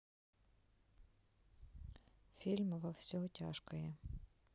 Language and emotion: Russian, neutral